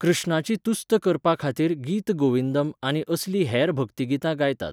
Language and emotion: Goan Konkani, neutral